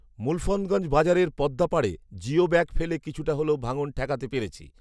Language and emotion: Bengali, neutral